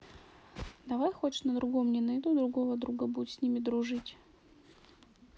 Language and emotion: Russian, neutral